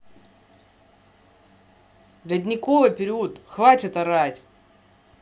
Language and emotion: Russian, angry